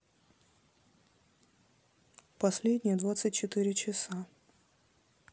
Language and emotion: Russian, neutral